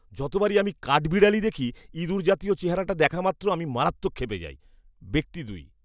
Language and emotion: Bengali, disgusted